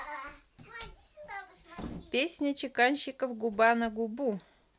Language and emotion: Russian, neutral